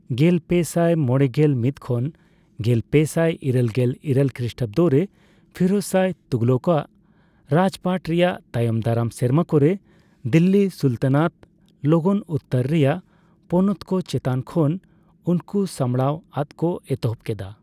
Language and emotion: Santali, neutral